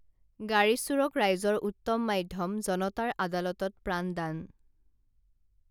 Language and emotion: Assamese, neutral